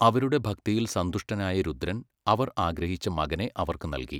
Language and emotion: Malayalam, neutral